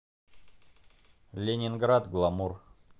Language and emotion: Russian, neutral